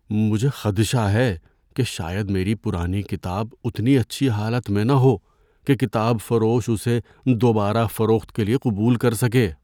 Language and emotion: Urdu, fearful